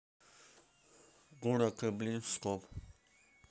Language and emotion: Russian, neutral